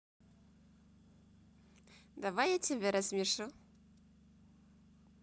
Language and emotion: Russian, positive